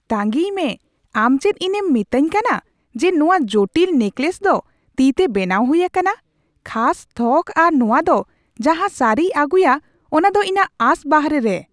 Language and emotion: Santali, surprised